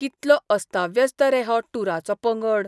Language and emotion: Goan Konkani, disgusted